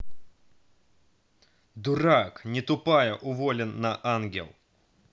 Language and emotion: Russian, angry